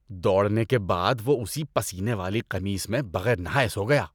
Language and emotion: Urdu, disgusted